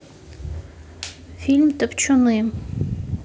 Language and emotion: Russian, neutral